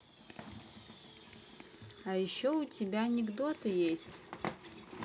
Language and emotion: Russian, neutral